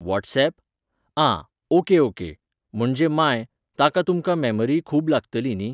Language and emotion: Goan Konkani, neutral